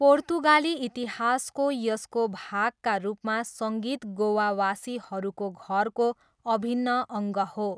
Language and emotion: Nepali, neutral